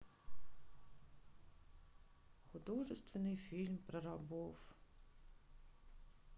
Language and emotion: Russian, sad